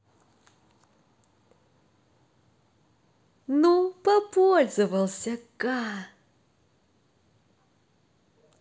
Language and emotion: Russian, positive